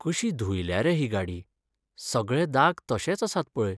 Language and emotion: Goan Konkani, sad